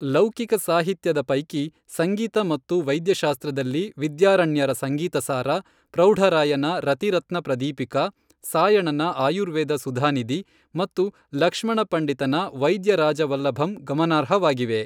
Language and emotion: Kannada, neutral